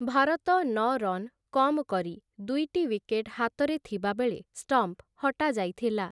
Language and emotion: Odia, neutral